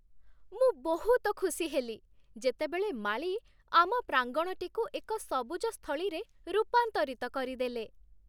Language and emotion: Odia, happy